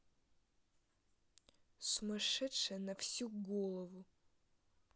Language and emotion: Russian, angry